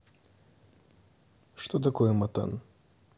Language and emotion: Russian, neutral